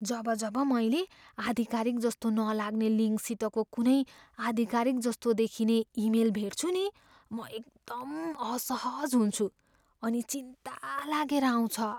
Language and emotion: Nepali, fearful